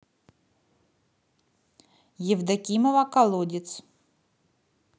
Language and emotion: Russian, neutral